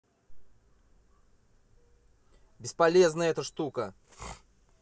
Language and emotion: Russian, angry